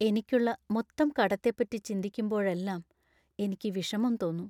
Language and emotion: Malayalam, sad